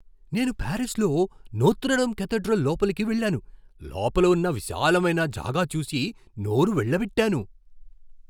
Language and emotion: Telugu, surprised